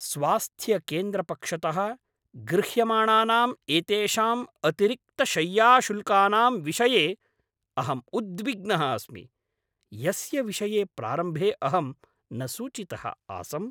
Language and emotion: Sanskrit, angry